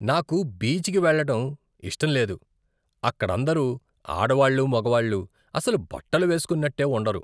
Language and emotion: Telugu, disgusted